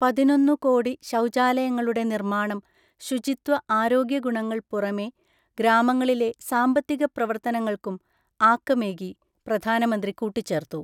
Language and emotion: Malayalam, neutral